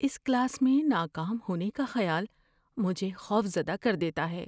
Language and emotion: Urdu, fearful